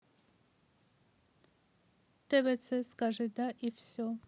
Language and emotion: Russian, neutral